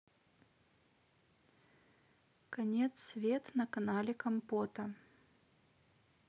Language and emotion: Russian, neutral